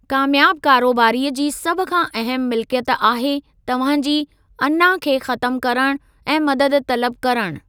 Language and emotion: Sindhi, neutral